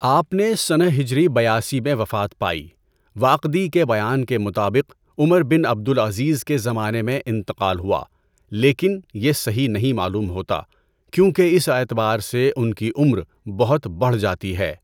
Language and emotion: Urdu, neutral